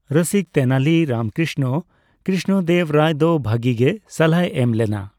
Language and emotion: Santali, neutral